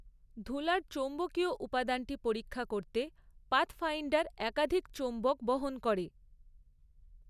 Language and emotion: Bengali, neutral